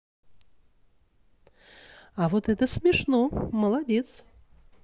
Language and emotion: Russian, positive